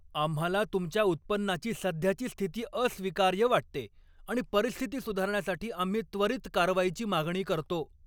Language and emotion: Marathi, angry